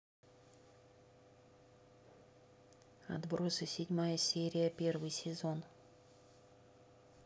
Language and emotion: Russian, neutral